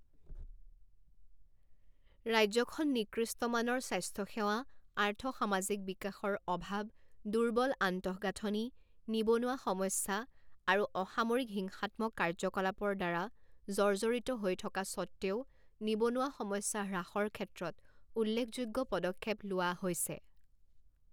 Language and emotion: Assamese, neutral